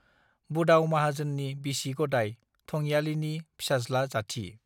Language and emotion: Bodo, neutral